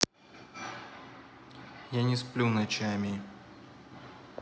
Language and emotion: Russian, sad